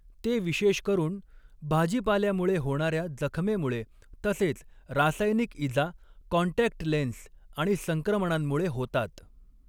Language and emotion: Marathi, neutral